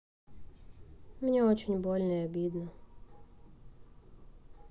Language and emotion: Russian, sad